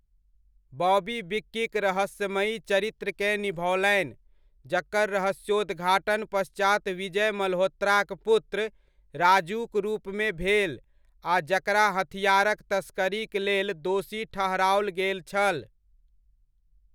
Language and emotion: Maithili, neutral